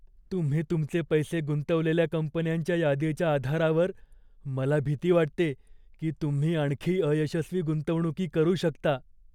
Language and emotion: Marathi, fearful